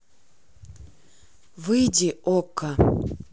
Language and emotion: Russian, neutral